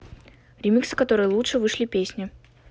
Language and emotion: Russian, neutral